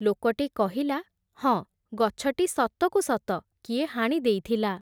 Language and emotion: Odia, neutral